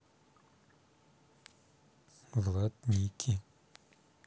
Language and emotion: Russian, neutral